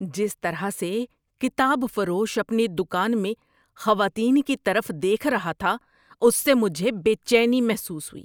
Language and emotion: Urdu, disgusted